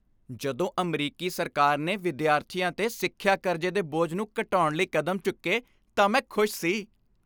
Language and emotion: Punjabi, happy